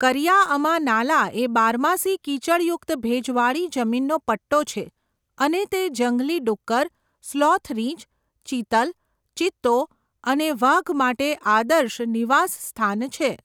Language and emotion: Gujarati, neutral